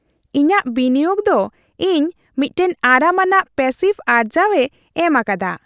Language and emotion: Santali, happy